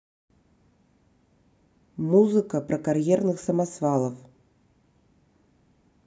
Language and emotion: Russian, neutral